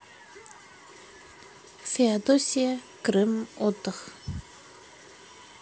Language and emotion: Russian, neutral